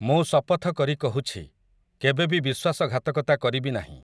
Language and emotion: Odia, neutral